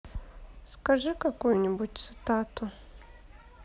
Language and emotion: Russian, sad